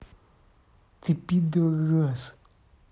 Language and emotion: Russian, angry